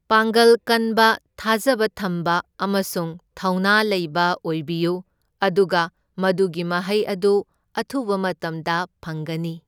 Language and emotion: Manipuri, neutral